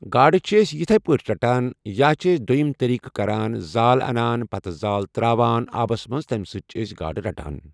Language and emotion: Kashmiri, neutral